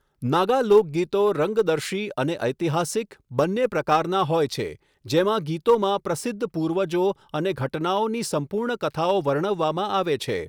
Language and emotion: Gujarati, neutral